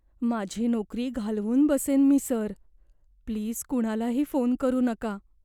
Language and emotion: Marathi, fearful